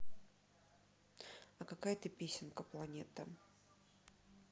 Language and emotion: Russian, neutral